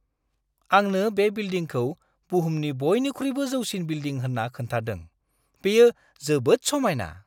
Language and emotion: Bodo, surprised